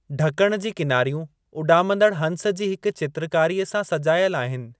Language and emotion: Sindhi, neutral